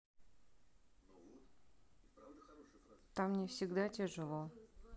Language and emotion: Russian, sad